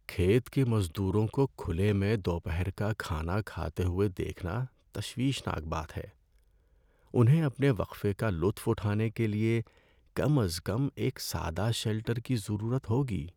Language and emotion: Urdu, sad